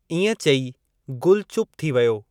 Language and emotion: Sindhi, neutral